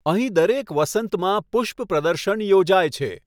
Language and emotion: Gujarati, neutral